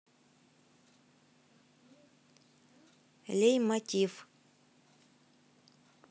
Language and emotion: Russian, neutral